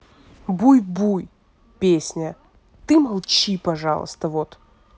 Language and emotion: Russian, angry